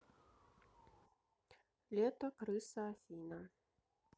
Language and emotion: Russian, neutral